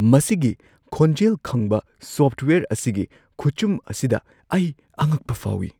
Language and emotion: Manipuri, surprised